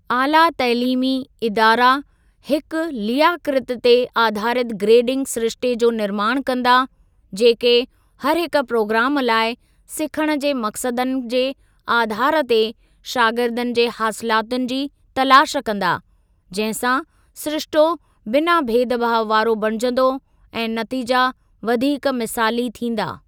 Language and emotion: Sindhi, neutral